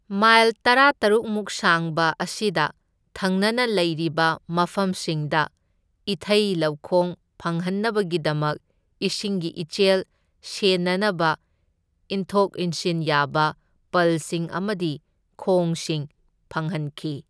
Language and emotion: Manipuri, neutral